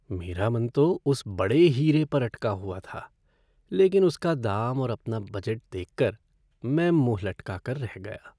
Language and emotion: Hindi, sad